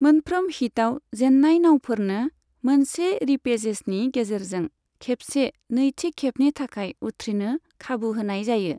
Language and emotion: Bodo, neutral